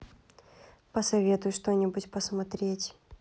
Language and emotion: Russian, neutral